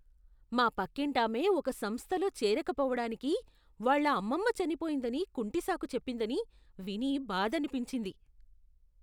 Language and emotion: Telugu, disgusted